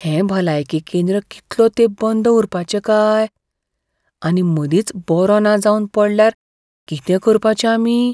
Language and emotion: Goan Konkani, fearful